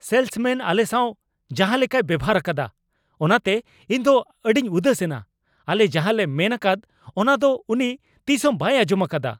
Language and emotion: Santali, angry